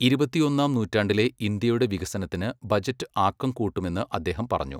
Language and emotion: Malayalam, neutral